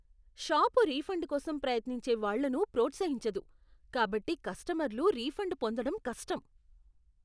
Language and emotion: Telugu, disgusted